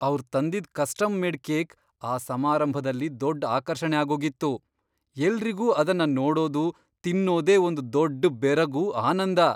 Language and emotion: Kannada, surprised